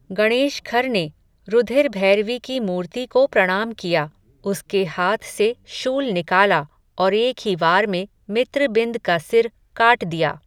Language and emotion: Hindi, neutral